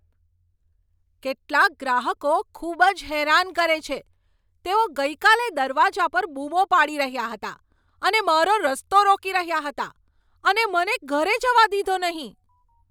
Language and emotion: Gujarati, angry